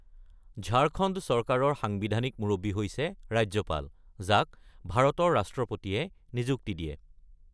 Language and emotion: Assamese, neutral